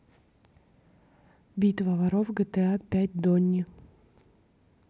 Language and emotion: Russian, neutral